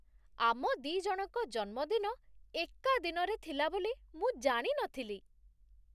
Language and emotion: Odia, surprised